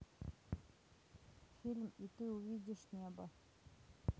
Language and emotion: Russian, neutral